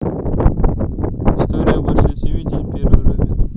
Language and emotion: Russian, neutral